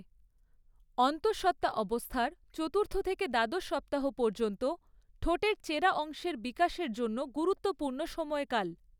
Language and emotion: Bengali, neutral